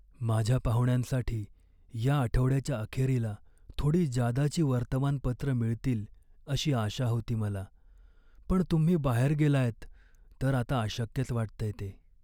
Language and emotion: Marathi, sad